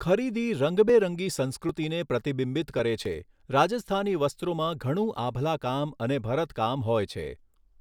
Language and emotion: Gujarati, neutral